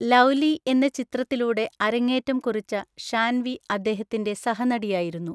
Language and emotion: Malayalam, neutral